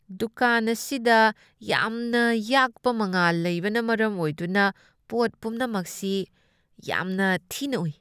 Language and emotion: Manipuri, disgusted